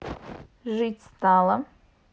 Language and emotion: Russian, neutral